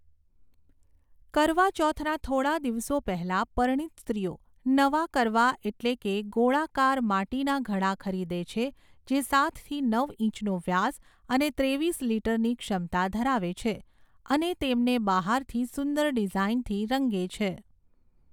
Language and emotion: Gujarati, neutral